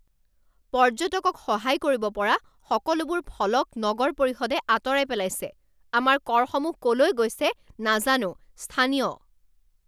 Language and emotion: Assamese, angry